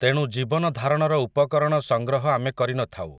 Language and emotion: Odia, neutral